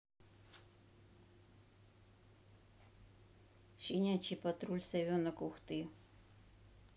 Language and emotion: Russian, neutral